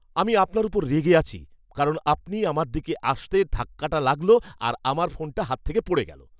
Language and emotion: Bengali, angry